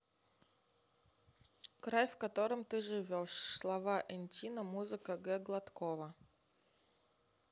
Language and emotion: Russian, neutral